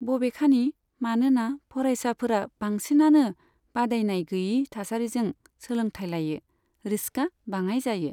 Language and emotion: Bodo, neutral